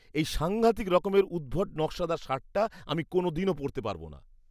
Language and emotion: Bengali, disgusted